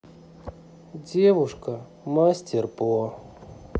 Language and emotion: Russian, sad